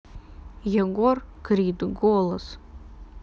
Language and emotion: Russian, neutral